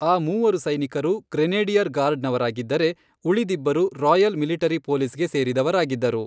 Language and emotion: Kannada, neutral